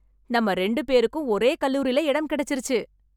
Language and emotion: Tamil, happy